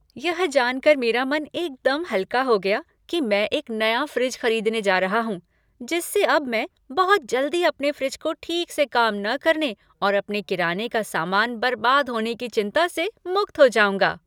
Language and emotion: Hindi, happy